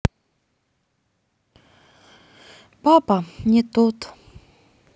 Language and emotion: Russian, sad